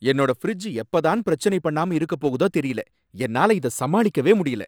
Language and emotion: Tamil, angry